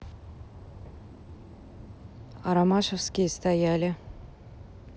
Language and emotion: Russian, neutral